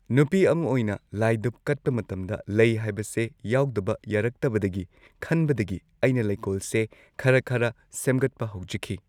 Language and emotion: Manipuri, neutral